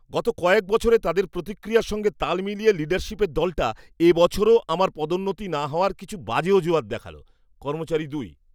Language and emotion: Bengali, disgusted